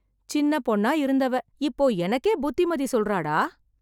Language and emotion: Tamil, surprised